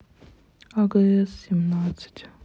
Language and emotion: Russian, sad